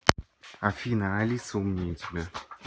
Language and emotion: Russian, neutral